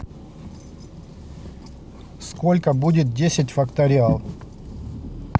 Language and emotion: Russian, neutral